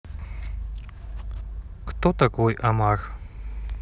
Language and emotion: Russian, neutral